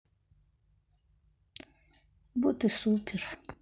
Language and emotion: Russian, sad